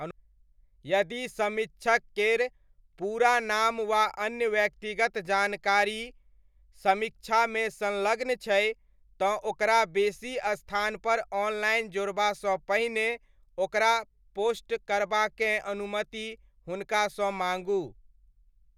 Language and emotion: Maithili, neutral